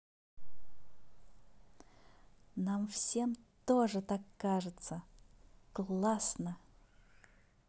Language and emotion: Russian, positive